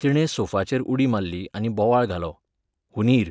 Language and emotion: Goan Konkani, neutral